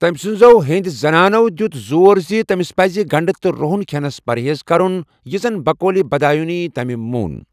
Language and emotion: Kashmiri, neutral